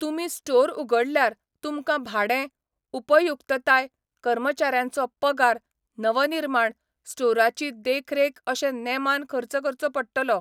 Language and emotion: Goan Konkani, neutral